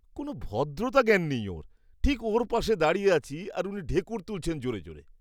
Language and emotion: Bengali, disgusted